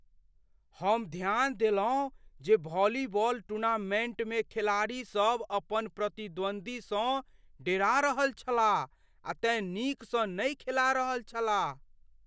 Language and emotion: Maithili, fearful